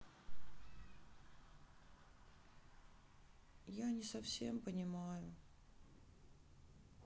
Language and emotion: Russian, sad